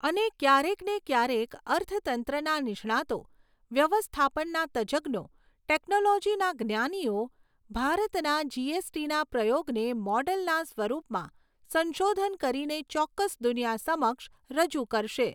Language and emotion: Gujarati, neutral